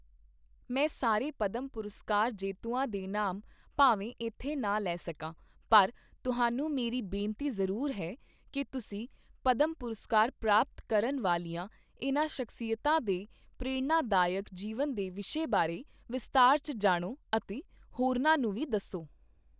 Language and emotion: Punjabi, neutral